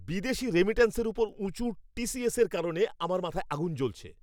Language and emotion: Bengali, angry